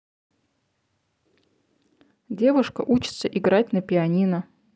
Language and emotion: Russian, neutral